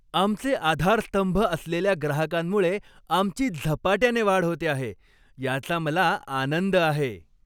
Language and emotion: Marathi, happy